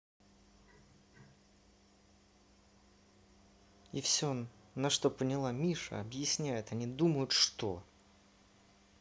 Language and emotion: Russian, angry